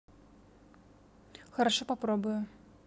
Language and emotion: Russian, neutral